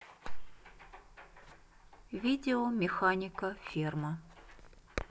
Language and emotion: Russian, neutral